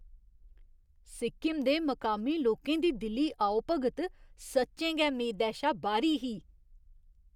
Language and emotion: Dogri, surprised